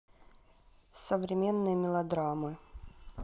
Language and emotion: Russian, neutral